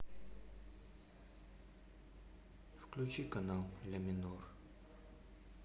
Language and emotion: Russian, sad